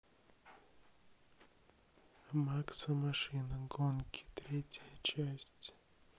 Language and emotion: Russian, neutral